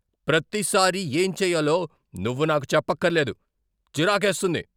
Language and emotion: Telugu, angry